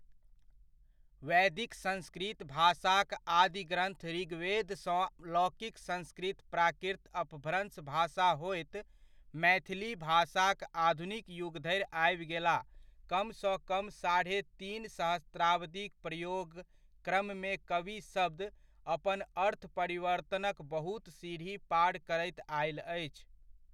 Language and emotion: Maithili, neutral